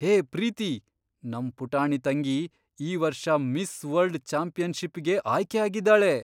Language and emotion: Kannada, surprised